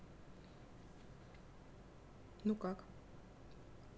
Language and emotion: Russian, neutral